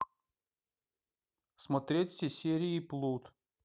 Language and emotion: Russian, neutral